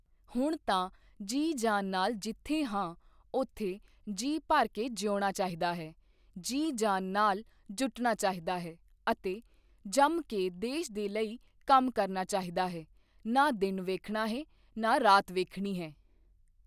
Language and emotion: Punjabi, neutral